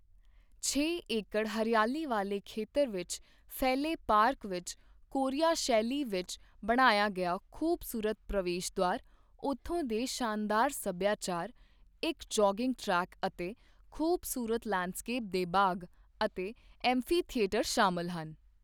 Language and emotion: Punjabi, neutral